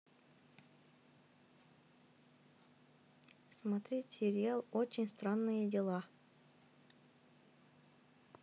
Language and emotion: Russian, neutral